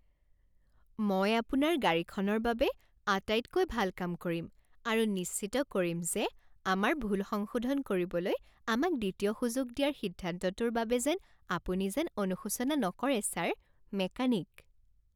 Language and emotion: Assamese, happy